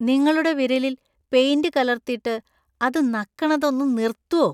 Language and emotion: Malayalam, disgusted